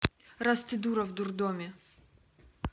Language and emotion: Russian, neutral